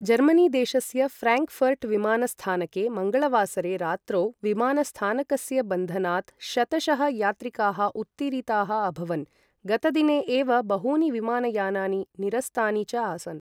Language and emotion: Sanskrit, neutral